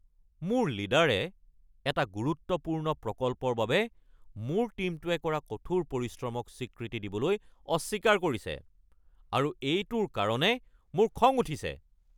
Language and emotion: Assamese, angry